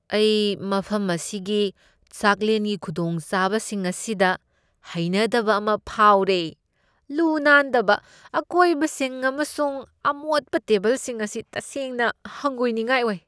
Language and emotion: Manipuri, disgusted